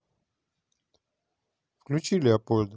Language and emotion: Russian, neutral